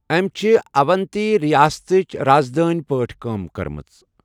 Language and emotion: Kashmiri, neutral